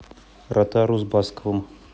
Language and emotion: Russian, neutral